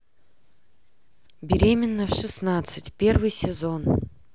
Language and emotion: Russian, neutral